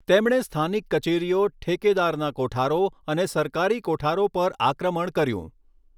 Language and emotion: Gujarati, neutral